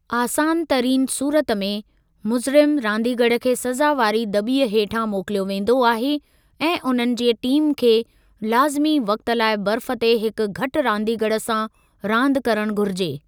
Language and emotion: Sindhi, neutral